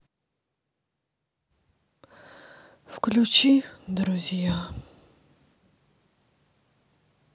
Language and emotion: Russian, sad